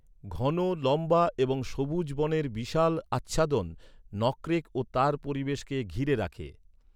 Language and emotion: Bengali, neutral